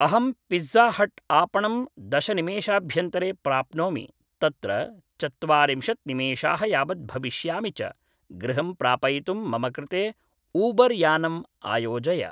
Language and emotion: Sanskrit, neutral